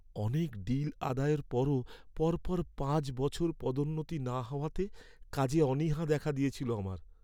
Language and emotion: Bengali, sad